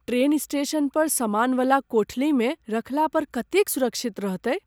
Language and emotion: Maithili, fearful